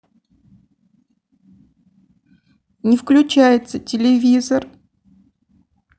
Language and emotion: Russian, sad